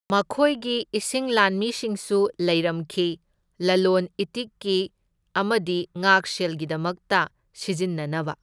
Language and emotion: Manipuri, neutral